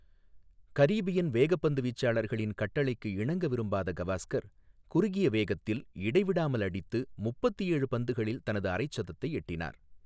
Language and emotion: Tamil, neutral